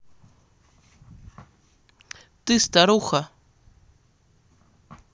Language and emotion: Russian, neutral